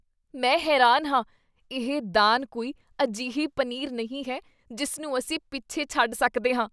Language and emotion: Punjabi, disgusted